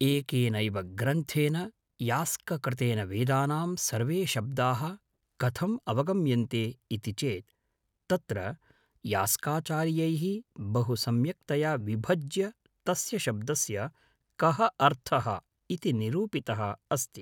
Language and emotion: Sanskrit, neutral